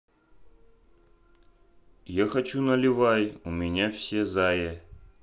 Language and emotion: Russian, neutral